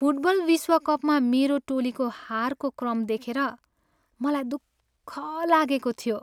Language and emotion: Nepali, sad